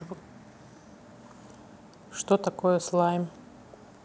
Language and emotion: Russian, neutral